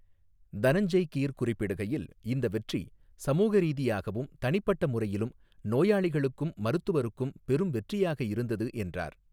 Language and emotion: Tamil, neutral